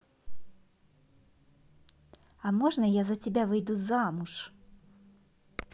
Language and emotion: Russian, positive